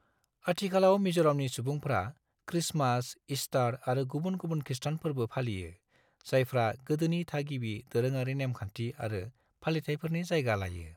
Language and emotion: Bodo, neutral